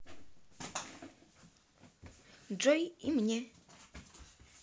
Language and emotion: Russian, neutral